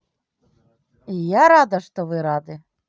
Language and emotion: Russian, positive